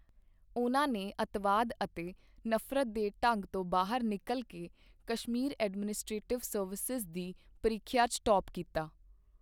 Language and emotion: Punjabi, neutral